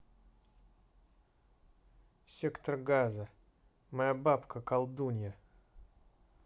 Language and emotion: Russian, neutral